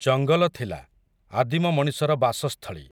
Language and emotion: Odia, neutral